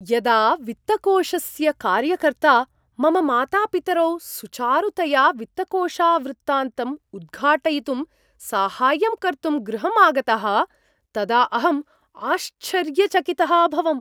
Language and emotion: Sanskrit, surprised